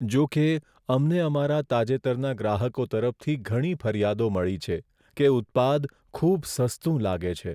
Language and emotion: Gujarati, sad